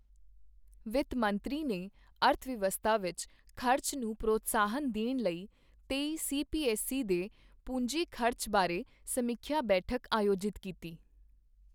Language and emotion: Punjabi, neutral